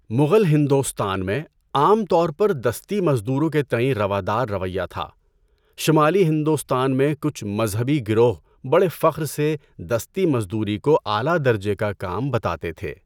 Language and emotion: Urdu, neutral